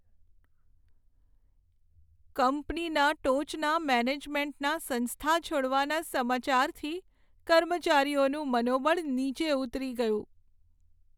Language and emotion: Gujarati, sad